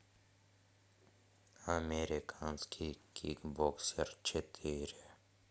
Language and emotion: Russian, neutral